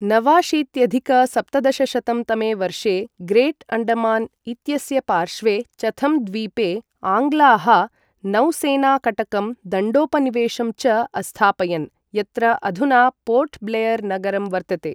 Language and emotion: Sanskrit, neutral